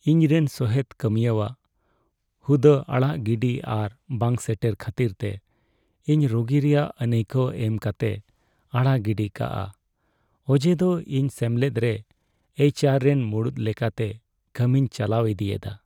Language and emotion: Santali, sad